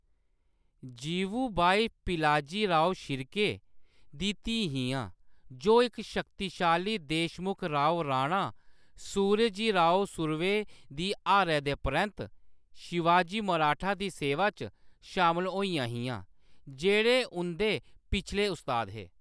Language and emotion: Dogri, neutral